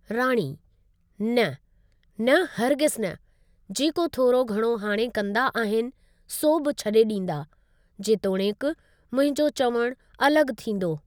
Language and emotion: Sindhi, neutral